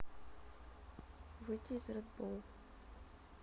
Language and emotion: Russian, sad